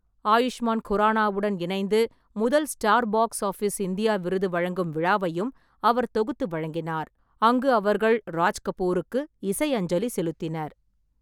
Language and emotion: Tamil, neutral